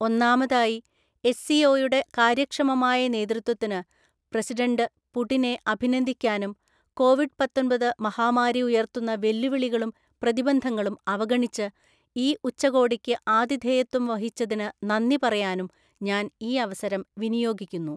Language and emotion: Malayalam, neutral